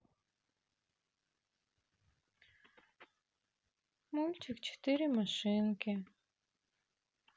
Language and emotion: Russian, sad